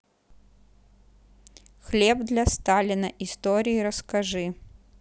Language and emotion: Russian, neutral